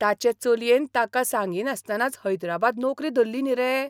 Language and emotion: Goan Konkani, surprised